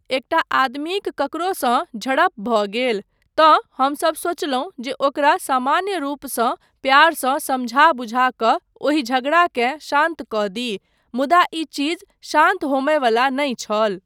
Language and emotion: Maithili, neutral